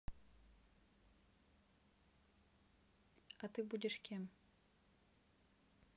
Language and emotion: Russian, neutral